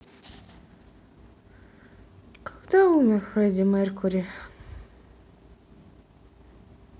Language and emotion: Russian, sad